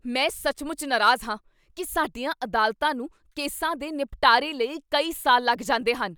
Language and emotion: Punjabi, angry